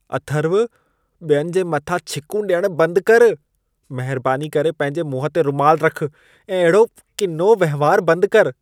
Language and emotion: Sindhi, disgusted